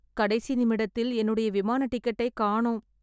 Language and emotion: Tamil, sad